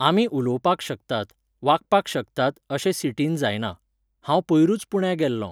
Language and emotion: Goan Konkani, neutral